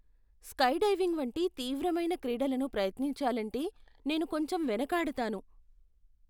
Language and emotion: Telugu, fearful